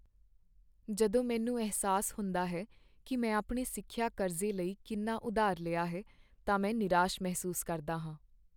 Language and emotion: Punjabi, sad